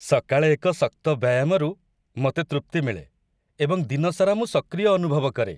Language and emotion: Odia, happy